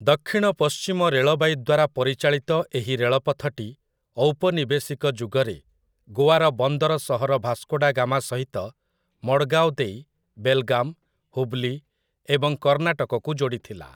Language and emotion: Odia, neutral